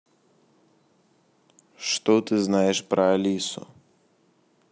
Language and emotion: Russian, neutral